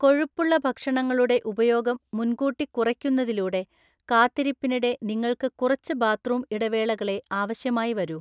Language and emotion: Malayalam, neutral